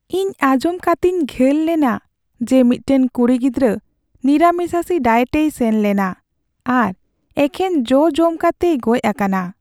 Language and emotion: Santali, sad